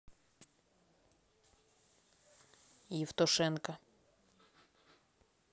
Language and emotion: Russian, neutral